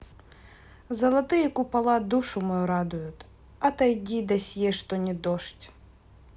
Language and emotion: Russian, neutral